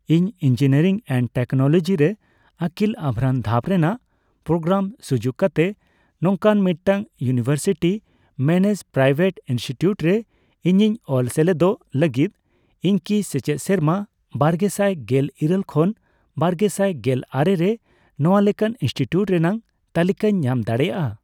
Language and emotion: Santali, neutral